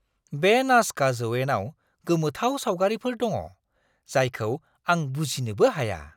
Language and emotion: Bodo, surprised